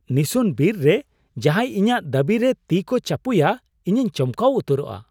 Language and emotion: Santali, surprised